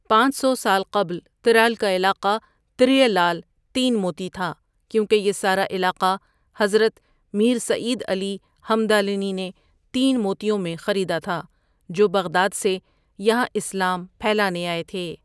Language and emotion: Urdu, neutral